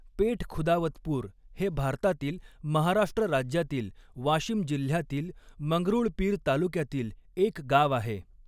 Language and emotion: Marathi, neutral